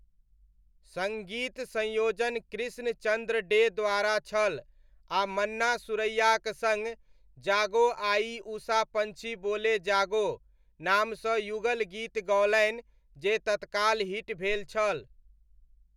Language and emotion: Maithili, neutral